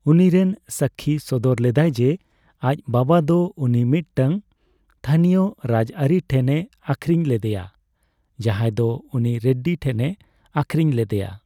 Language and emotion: Santali, neutral